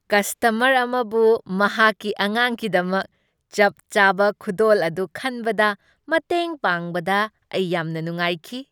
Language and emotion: Manipuri, happy